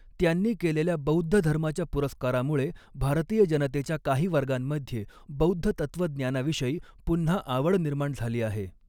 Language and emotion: Marathi, neutral